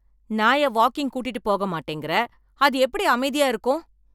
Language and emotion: Tamil, angry